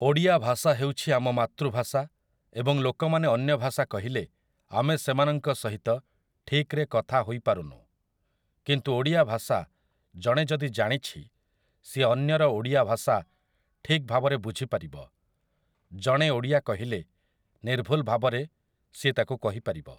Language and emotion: Odia, neutral